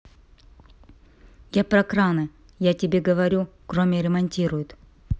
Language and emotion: Russian, neutral